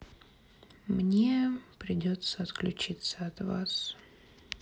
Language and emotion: Russian, sad